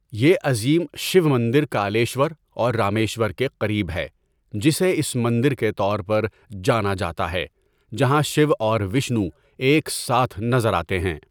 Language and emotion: Urdu, neutral